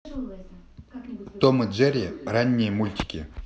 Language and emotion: Russian, neutral